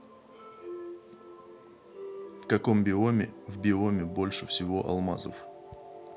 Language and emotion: Russian, neutral